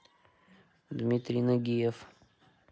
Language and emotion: Russian, neutral